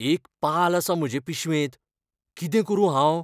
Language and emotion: Goan Konkani, fearful